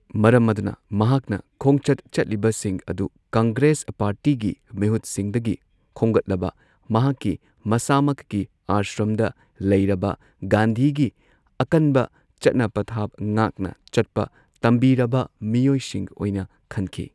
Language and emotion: Manipuri, neutral